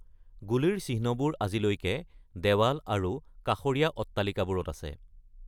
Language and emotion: Assamese, neutral